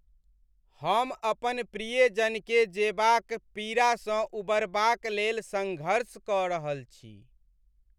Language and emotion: Maithili, sad